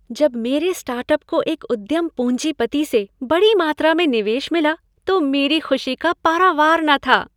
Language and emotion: Hindi, happy